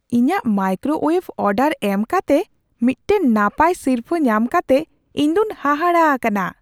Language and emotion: Santali, surprised